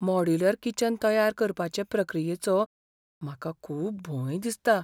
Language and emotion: Goan Konkani, fearful